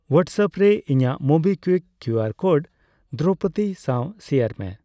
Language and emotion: Santali, neutral